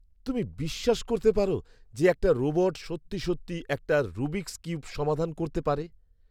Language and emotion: Bengali, surprised